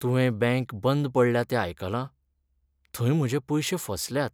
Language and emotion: Goan Konkani, sad